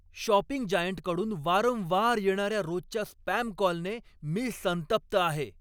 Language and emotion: Marathi, angry